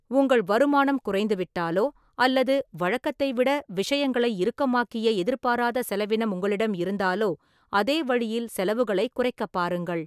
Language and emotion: Tamil, neutral